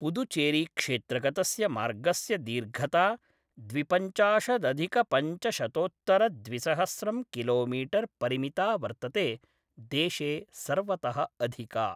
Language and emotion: Sanskrit, neutral